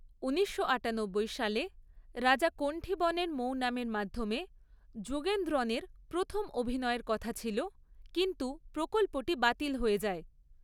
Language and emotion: Bengali, neutral